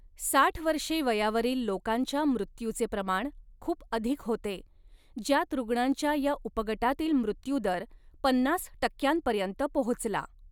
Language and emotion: Marathi, neutral